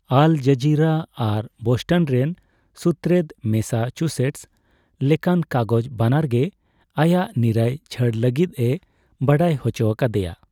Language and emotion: Santali, neutral